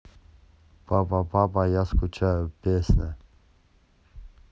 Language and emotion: Russian, neutral